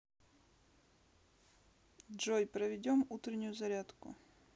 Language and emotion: Russian, neutral